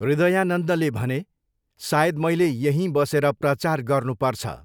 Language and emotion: Nepali, neutral